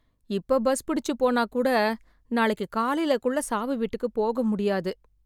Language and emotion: Tamil, sad